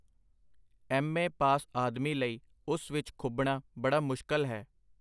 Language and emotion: Punjabi, neutral